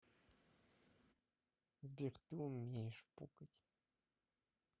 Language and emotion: Russian, neutral